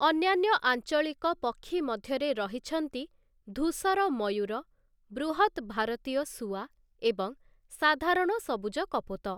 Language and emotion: Odia, neutral